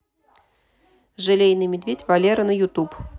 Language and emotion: Russian, neutral